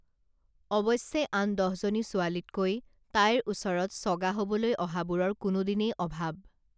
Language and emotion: Assamese, neutral